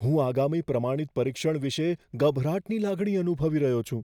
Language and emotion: Gujarati, fearful